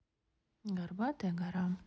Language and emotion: Russian, neutral